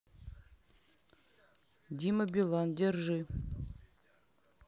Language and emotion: Russian, neutral